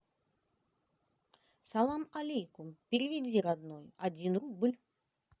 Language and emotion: Russian, positive